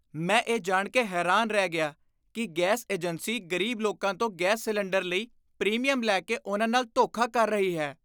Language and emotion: Punjabi, disgusted